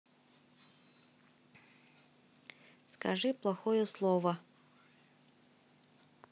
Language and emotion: Russian, neutral